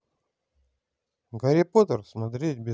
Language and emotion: Russian, positive